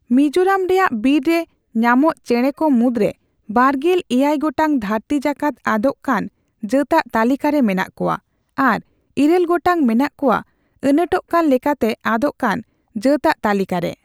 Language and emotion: Santali, neutral